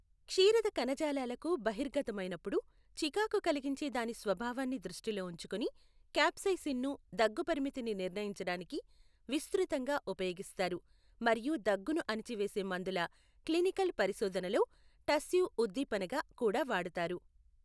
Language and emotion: Telugu, neutral